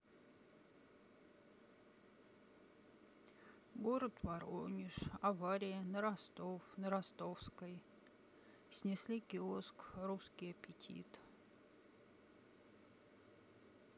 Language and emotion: Russian, sad